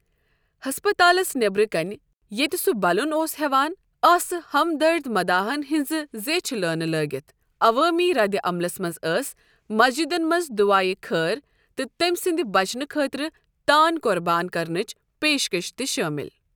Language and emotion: Kashmiri, neutral